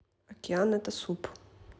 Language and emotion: Russian, neutral